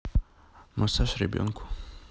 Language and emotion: Russian, neutral